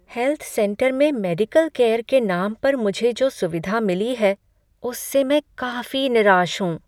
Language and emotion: Hindi, sad